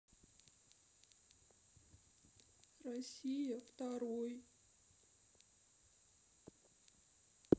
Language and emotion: Russian, sad